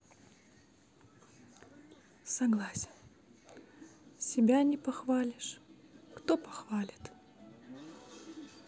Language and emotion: Russian, sad